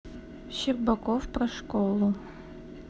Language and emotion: Russian, neutral